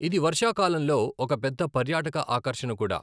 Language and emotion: Telugu, neutral